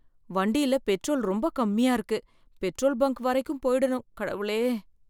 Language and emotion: Tamil, fearful